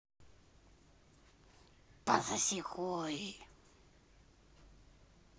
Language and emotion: Russian, angry